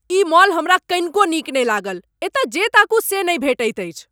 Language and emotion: Maithili, angry